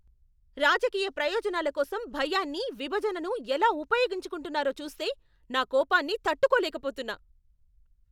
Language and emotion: Telugu, angry